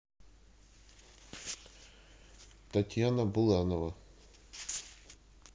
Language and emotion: Russian, neutral